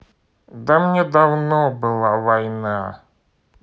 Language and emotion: Russian, sad